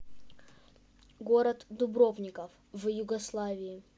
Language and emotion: Russian, neutral